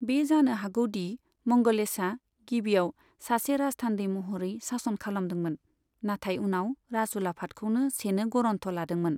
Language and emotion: Bodo, neutral